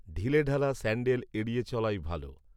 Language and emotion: Bengali, neutral